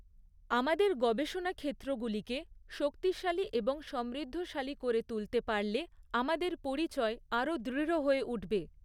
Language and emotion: Bengali, neutral